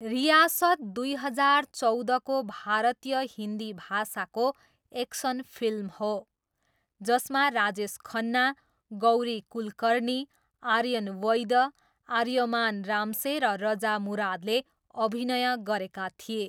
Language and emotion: Nepali, neutral